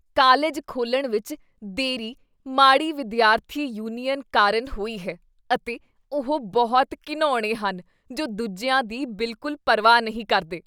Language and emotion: Punjabi, disgusted